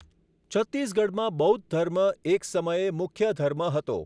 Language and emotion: Gujarati, neutral